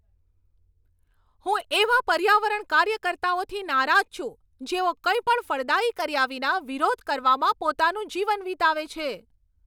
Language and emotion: Gujarati, angry